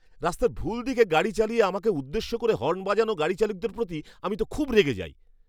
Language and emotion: Bengali, angry